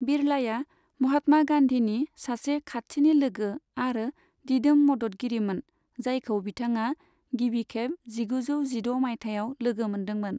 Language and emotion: Bodo, neutral